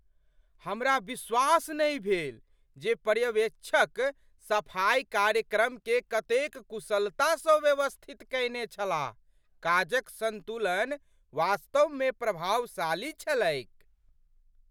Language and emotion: Maithili, surprised